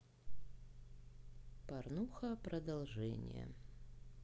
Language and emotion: Russian, neutral